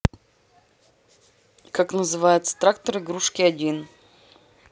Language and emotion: Russian, neutral